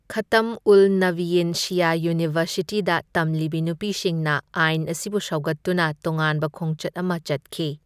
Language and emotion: Manipuri, neutral